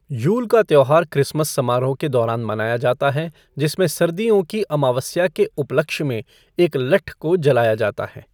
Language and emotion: Hindi, neutral